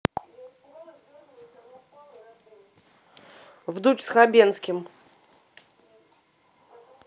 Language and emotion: Russian, neutral